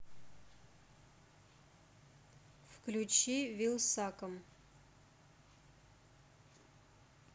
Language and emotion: Russian, neutral